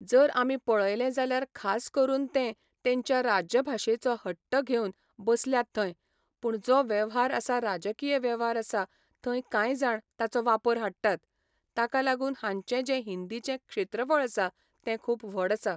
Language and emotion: Goan Konkani, neutral